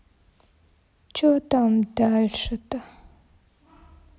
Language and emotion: Russian, sad